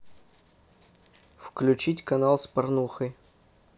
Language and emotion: Russian, neutral